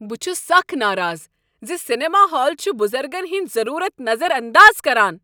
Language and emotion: Kashmiri, angry